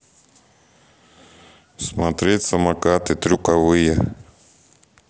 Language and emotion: Russian, neutral